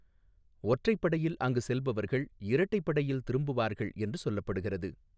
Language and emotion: Tamil, neutral